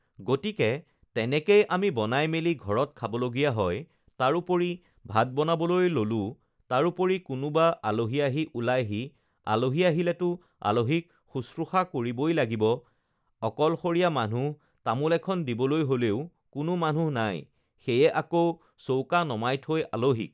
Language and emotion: Assamese, neutral